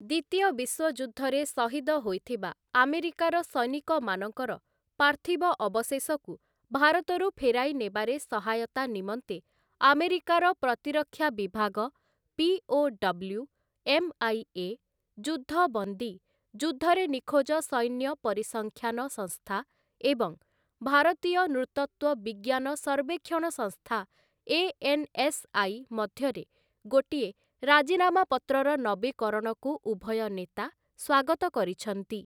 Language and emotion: Odia, neutral